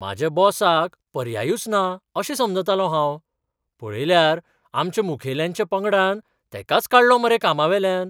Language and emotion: Goan Konkani, surprised